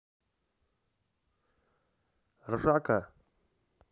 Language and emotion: Russian, neutral